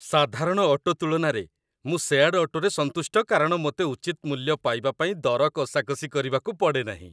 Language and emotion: Odia, happy